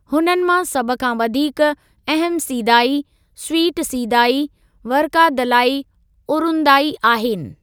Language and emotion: Sindhi, neutral